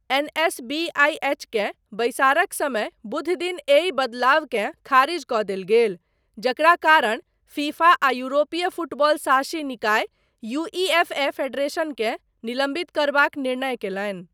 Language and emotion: Maithili, neutral